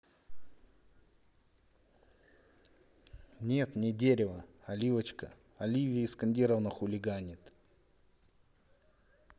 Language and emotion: Russian, neutral